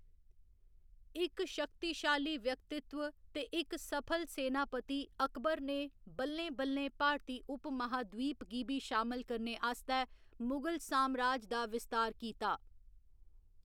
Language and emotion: Dogri, neutral